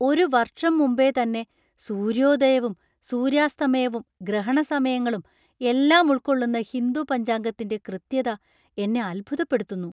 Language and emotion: Malayalam, surprised